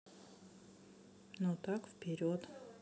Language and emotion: Russian, neutral